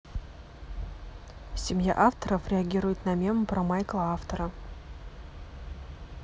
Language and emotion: Russian, neutral